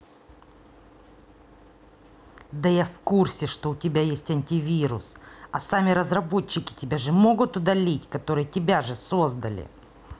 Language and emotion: Russian, angry